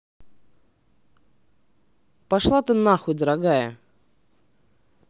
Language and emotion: Russian, angry